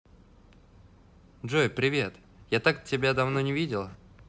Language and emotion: Russian, positive